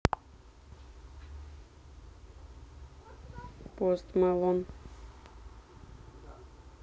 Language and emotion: Russian, neutral